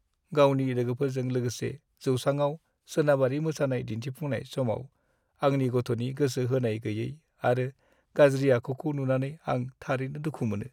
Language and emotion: Bodo, sad